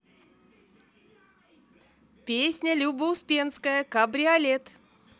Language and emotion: Russian, positive